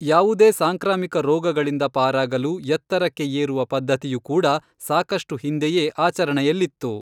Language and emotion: Kannada, neutral